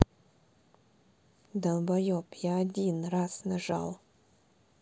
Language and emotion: Russian, neutral